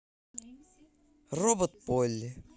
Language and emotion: Russian, positive